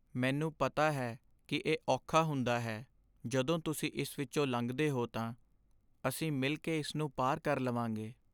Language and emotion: Punjabi, sad